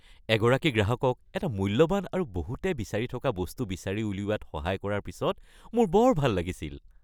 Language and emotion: Assamese, happy